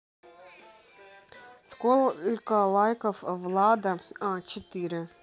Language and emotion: Russian, neutral